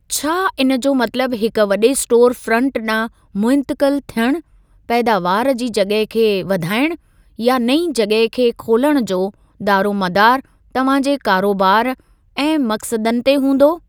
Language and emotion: Sindhi, neutral